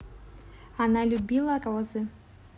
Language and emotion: Russian, neutral